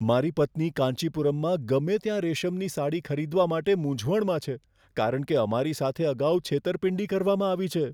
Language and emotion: Gujarati, fearful